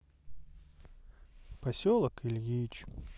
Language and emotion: Russian, sad